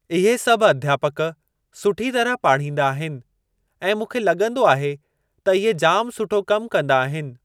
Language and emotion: Sindhi, neutral